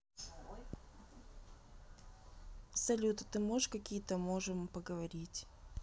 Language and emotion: Russian, neutral